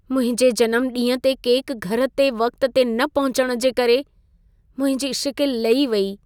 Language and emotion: Sindhi, sad